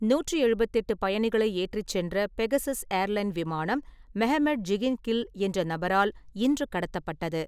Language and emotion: Tamil, neutral